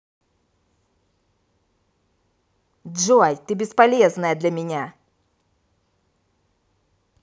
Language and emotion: Russian, angry